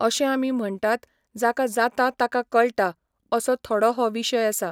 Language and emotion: Goan Konkani, neutral